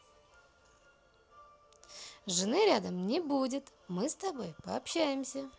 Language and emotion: Russian, positive